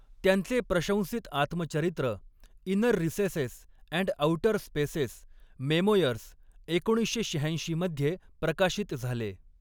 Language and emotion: Marathi, neutral